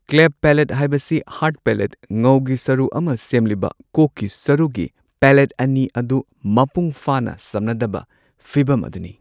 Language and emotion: Manipuri, neutral